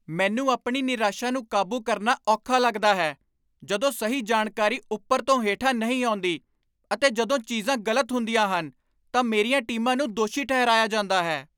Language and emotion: Punjabi, angry